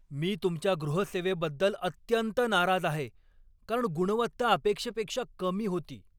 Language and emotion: Marathi, angry